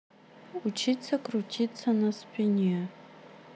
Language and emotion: Russian, neutral